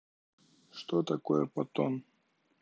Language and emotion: Russian, neutral